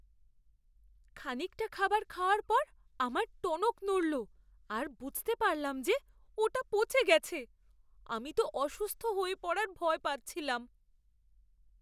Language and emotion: Bengali, fearful